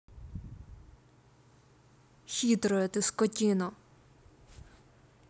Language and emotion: Russian, angry